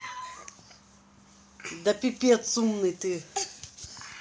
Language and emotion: Russian, neutral